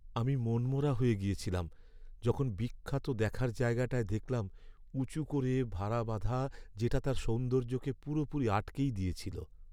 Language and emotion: Bengali, sad